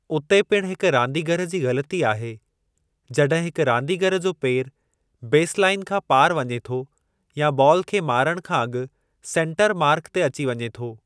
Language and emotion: Sindhi, neutral